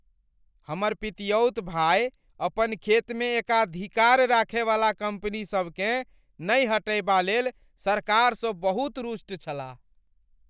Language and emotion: Maithili, angry